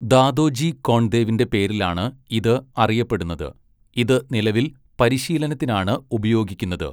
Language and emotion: Malayalam, neutral